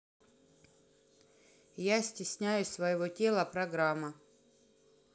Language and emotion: Russian, neutral